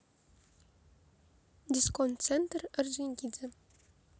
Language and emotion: Russian, neutral